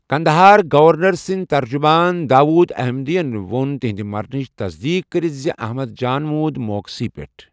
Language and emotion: Kashmiri, neutral